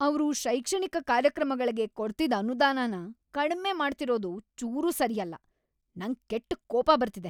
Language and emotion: Kannada, angry